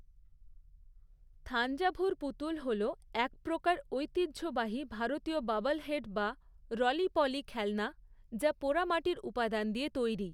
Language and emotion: Bengali, neutral